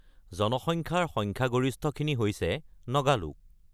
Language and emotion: Assamese, neutral